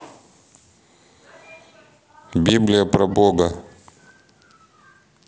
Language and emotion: Russian, neutral